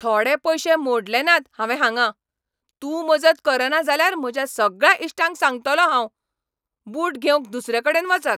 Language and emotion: Goan Konkani, angry